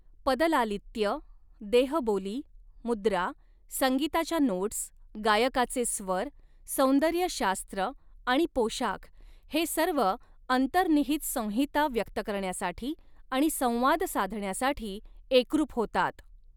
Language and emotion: Marathi, neutral